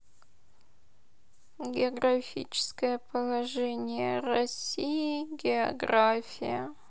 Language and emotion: Russian, sad